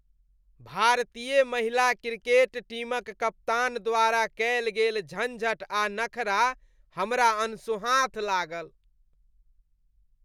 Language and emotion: Maithili, disgusted